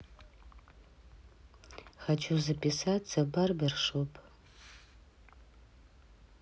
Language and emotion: Russian, neutral